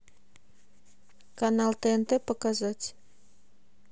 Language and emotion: Russian, neutral